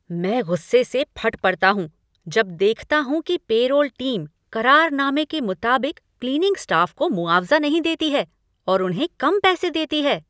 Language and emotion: Hindi, angry